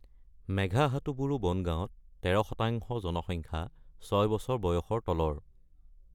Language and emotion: Assamese, neutral